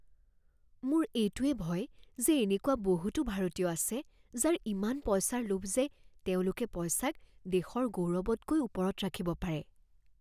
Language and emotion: Assamese, fearful